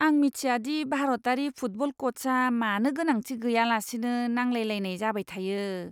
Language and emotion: Bodo, disgusted